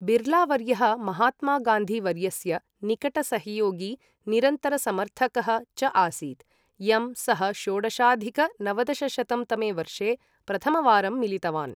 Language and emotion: Sanskrit, neutral